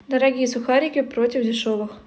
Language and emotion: Russian, neutral